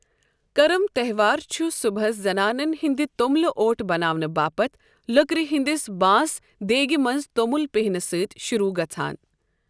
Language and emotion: Kashmiri, neutral